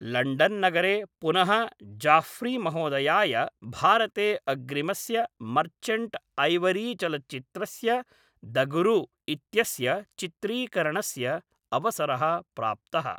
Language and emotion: Sanskrit, neutral